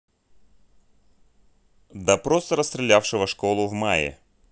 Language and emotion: Russian, neutral